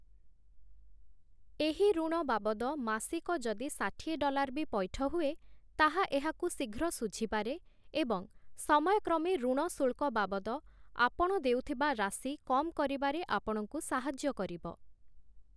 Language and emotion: Odia, neutral